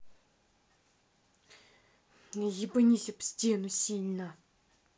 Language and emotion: Russian, angry